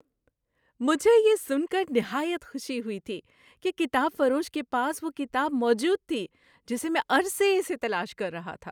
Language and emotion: Urdu, happy